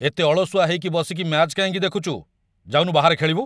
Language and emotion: Odia, angry